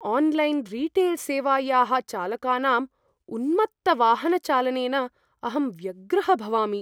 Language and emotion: Sanskrit, fearful